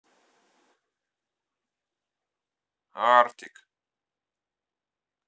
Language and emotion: Russian, neutral